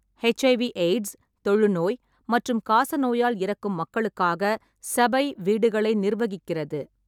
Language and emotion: Tamil, neutral